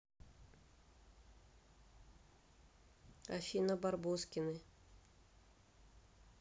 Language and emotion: Russian, neutral